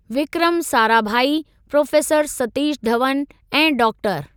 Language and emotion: Sindhi, neutral